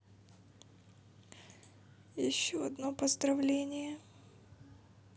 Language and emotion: Russian, sad